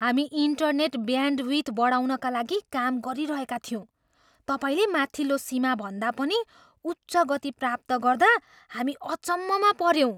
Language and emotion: Nepali, surprised